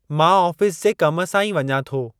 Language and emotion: Sindhi, neutral